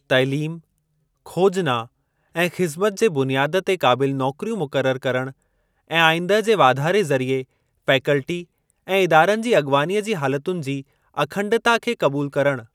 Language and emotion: Sindhi, neutral